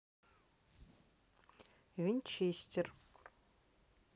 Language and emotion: Russian, neutral